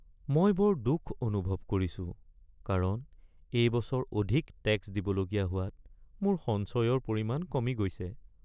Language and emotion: Assamese, sad